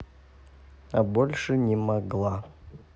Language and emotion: Russian, sad